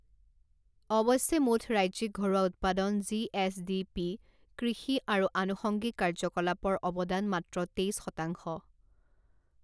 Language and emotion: Assamese, neutral